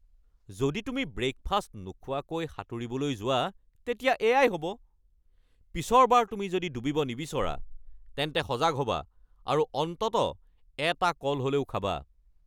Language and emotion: Assamese, angry